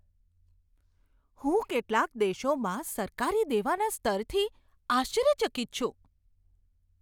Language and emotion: Gujarati, surprised